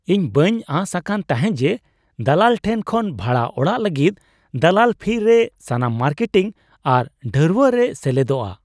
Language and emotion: Santali, surprised